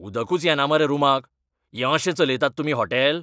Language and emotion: Goan Konkani, angry